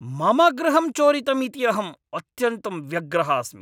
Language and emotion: Sanskrit, angry